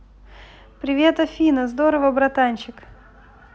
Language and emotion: Russian, positive